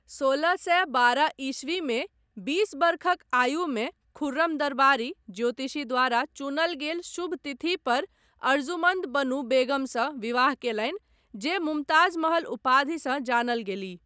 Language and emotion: Maithili, neutral